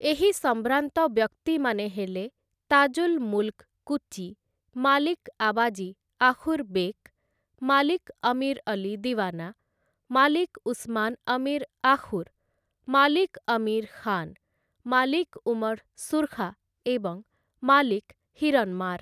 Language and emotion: Odia, neutral